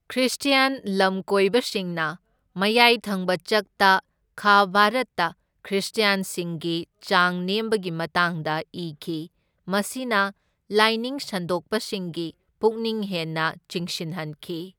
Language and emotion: Manipuri, neutral